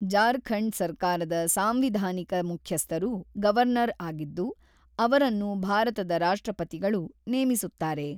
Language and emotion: Kannada, neutral